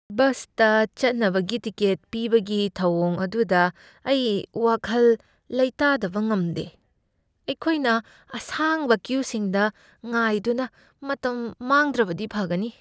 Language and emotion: Manipuri, fearful